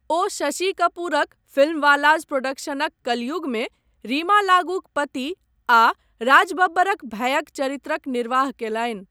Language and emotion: Maithili, neutral